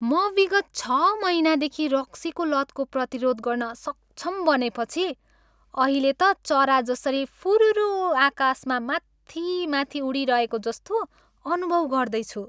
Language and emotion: Nepali, happy